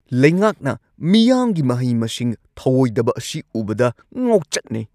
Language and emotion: Manipuri, angry